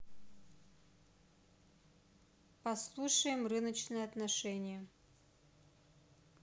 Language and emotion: Russian, neutral